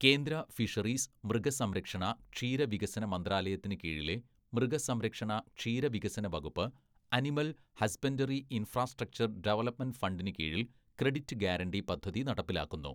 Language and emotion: Malayalam, neutral